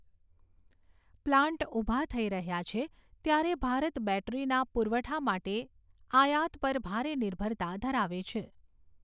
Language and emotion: Gujarati, neutral